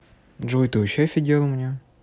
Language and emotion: Russian, neutral